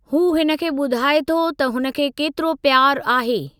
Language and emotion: Sindhi, neutral